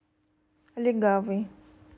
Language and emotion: Russian, neutral